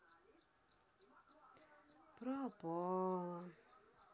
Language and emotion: Russian, sad